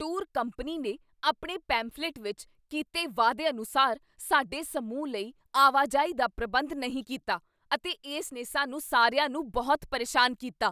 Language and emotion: Punjabi, angry